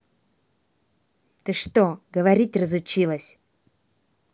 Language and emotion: Russian, angry